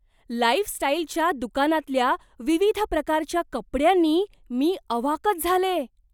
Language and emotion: Marathi, surprised